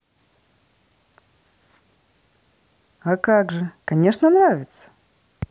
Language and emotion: Russian, positive